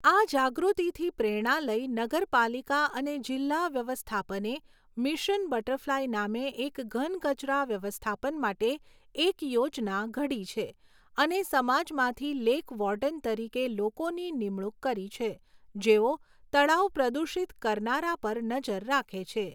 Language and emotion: Gujarati, neutral